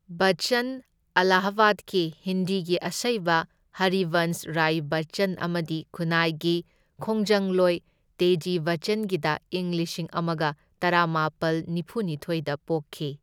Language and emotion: Manipuri, neutral